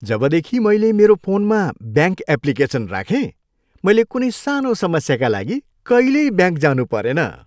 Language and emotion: Nepali, happy